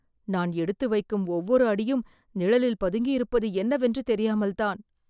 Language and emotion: Tamil, fearful